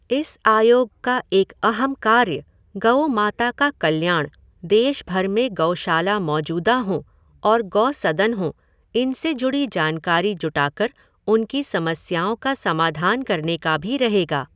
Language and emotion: Hindi, neutral